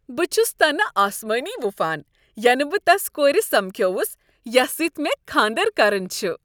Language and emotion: Kashmiri, happy